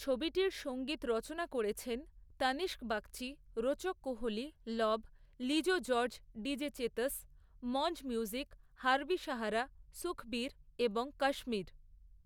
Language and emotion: Bengali, neutral